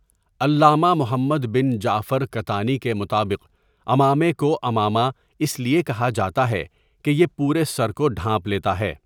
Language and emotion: Urdu, neutral